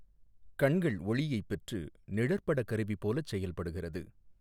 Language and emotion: Tamil, neutral